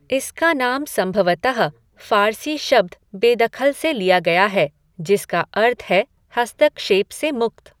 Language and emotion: Hindi, neutral